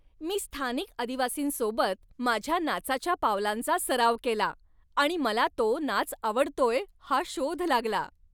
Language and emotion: Marathi, happy